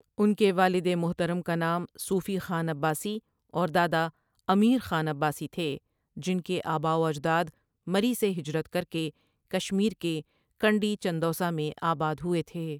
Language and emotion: Urdu, neutral